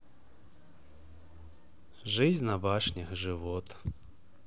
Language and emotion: Russian, neutral